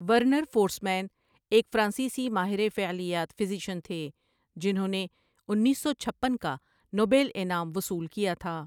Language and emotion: Urdu, neutral